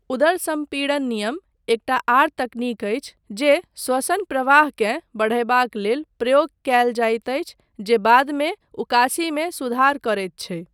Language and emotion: Maithili, neutral